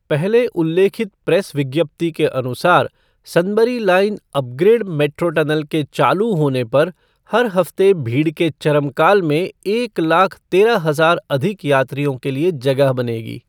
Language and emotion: Hindi, neutral